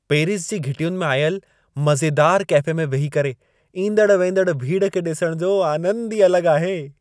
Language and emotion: Sindhi, happy